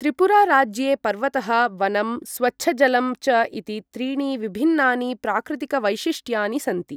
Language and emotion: Sanskrit, neutral